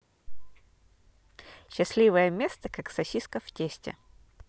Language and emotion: Russian, positive